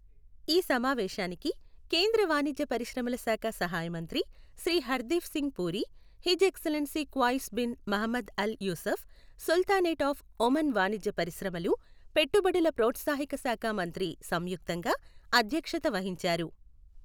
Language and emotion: Telugu, neutral